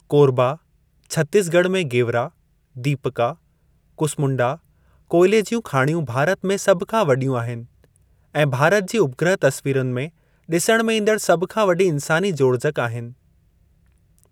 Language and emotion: Sindhi, neutral